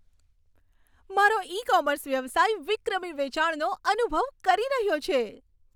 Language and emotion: Gujarati, happy